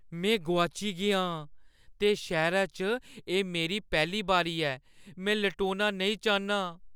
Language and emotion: Dogri, fearful